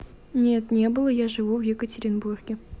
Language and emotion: Russian, neutral